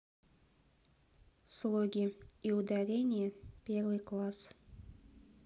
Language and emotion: Russian, neutral